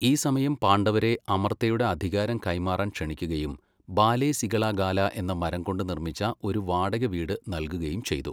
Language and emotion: Malayalam, neutral